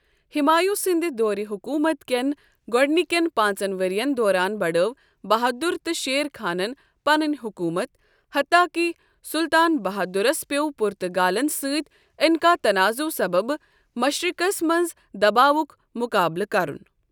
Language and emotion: Kashmiri, neutral